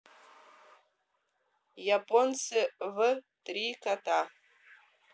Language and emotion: Russian, neutral